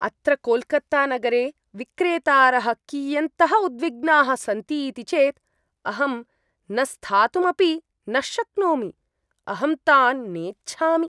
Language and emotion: Sanskrit, disgusted